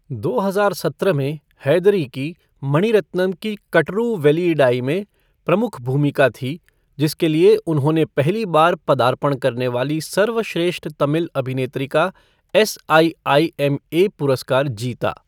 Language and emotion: Hindi, neutral